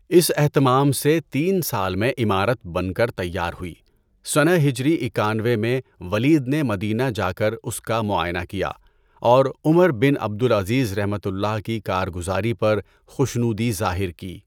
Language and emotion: Urdu, neutral